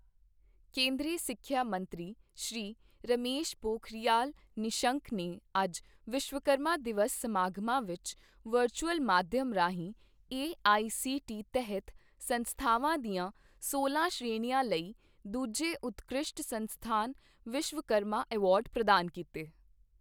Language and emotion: Punjabi, neutral